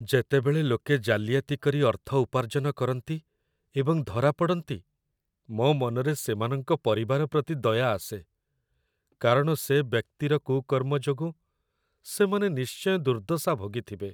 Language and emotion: Odia, sad